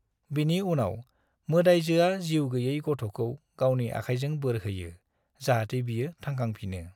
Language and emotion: Bodo, neutral